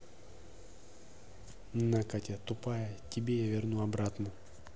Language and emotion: Russian, angry